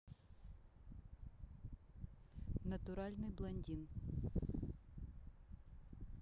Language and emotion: Russian, neutral